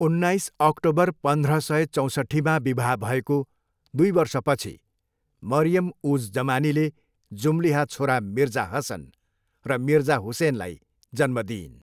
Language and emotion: Nepali, neutral